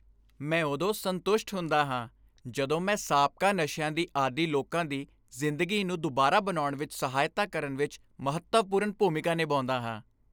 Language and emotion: Punjabi, happy